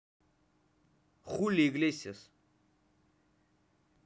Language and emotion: Russian, neutral